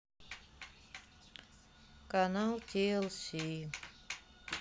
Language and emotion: Russian, sad